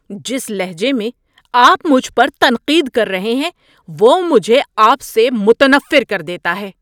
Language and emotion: Urdu, angry